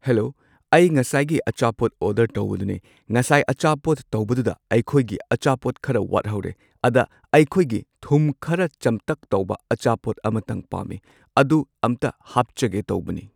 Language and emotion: Manipuri, neutral